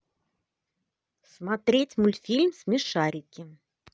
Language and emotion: Russian, positive